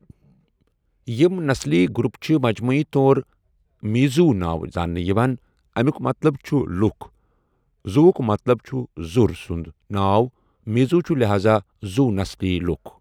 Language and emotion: Kashmiri, neutral